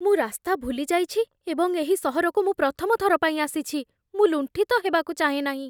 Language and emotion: Odia, fearful